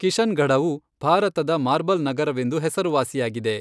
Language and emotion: Kannada, neutral